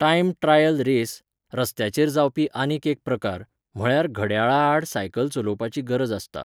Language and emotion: Goan Konkani, neutral